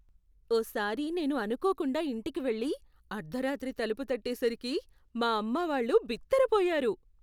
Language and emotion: Telugu, surprised